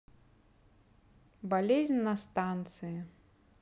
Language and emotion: Russian, neutral